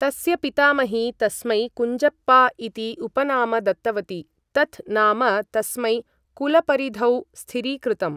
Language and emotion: Sanskrit, neutral